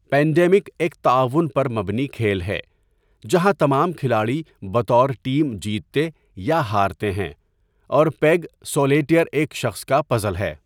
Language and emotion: Urdu, neutral